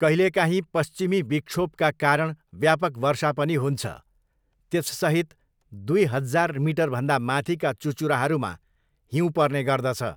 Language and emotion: Nepali, neutral